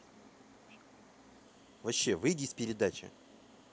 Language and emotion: Russian, angry